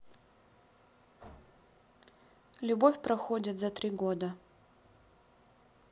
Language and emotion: Russian, neutral